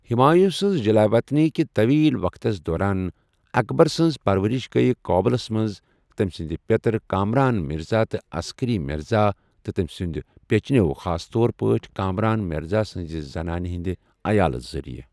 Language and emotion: Kashmiri, neutral